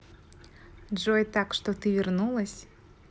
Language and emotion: Russian, positive